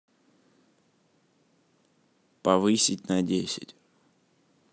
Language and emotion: Russian, neutral